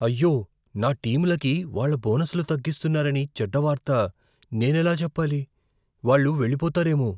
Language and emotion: Telugu, fearful